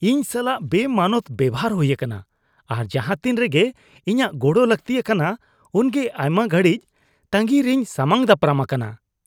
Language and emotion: Santali, disgusted